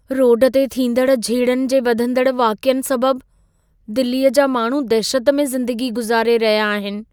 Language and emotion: Sindhi, fearful